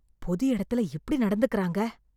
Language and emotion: Tamil, disgusted